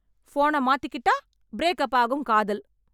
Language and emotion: Tamil, angry